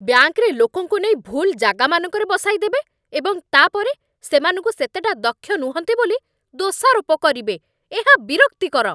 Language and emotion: Odia, angry